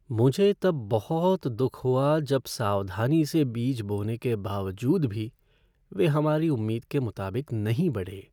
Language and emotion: Hindi, sad